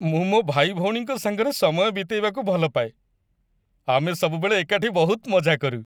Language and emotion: Odia, happy